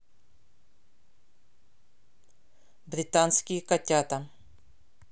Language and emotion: Russian, neutral